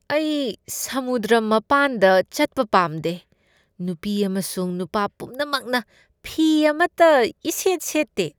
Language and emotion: Manipuri, disgusted